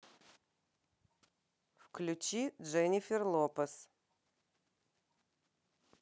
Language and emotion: Russian, neutral